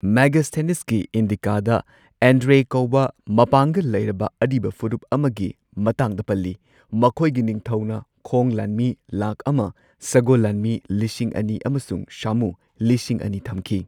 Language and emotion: Manipuri, neutral